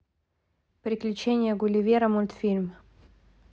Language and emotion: Russian, neutral